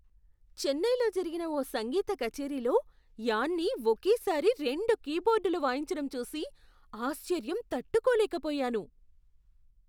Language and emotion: Telugu, surprised